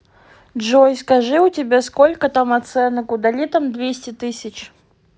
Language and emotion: Russian, neutral